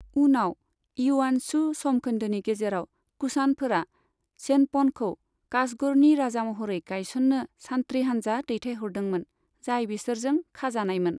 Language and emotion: Bodo, neutral